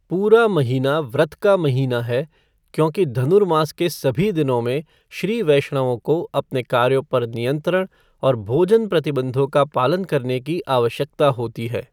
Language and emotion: Hindi, neutral